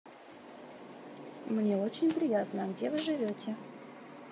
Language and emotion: Russian, neutral